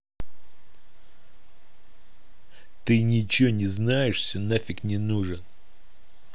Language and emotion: Russian, angry